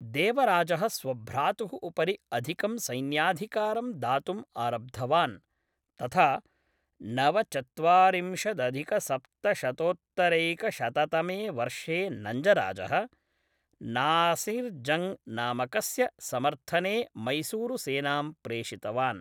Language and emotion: Sanskrit, neutral